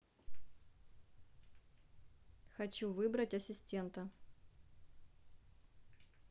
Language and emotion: Russian, neutral